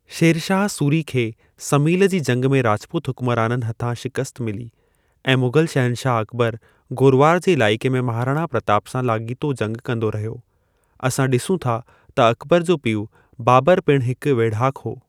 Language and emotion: Sindhi, neutral